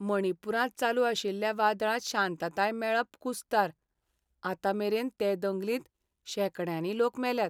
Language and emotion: Goan Konkani, sad